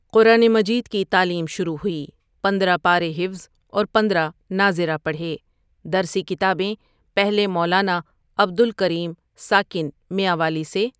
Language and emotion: Urdu, neutral